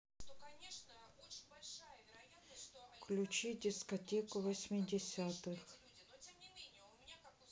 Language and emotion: Russian, neutral